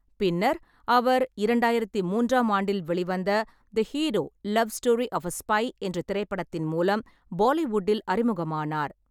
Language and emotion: Tamil, neutral